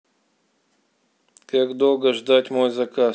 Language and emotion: Russian, angry